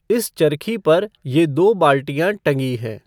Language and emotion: Hindi, neutral